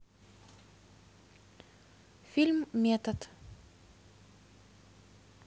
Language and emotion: Russian, neutral